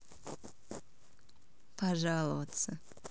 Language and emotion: Russian, neutral